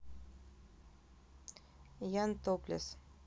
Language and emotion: Russian, neutral